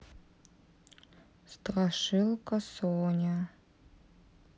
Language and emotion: Russian, sad